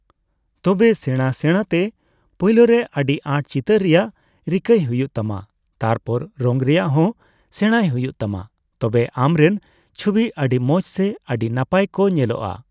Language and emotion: Santali, neutral